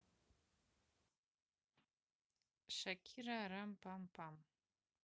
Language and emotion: Russian, neutral